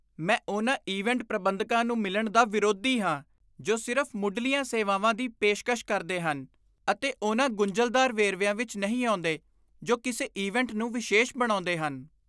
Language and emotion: Punjabi, disgusted